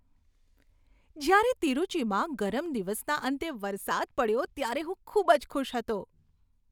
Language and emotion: Gujarati, happy